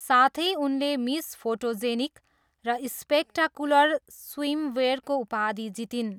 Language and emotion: Nepali, neutral